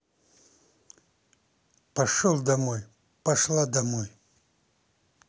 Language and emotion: Russian, angry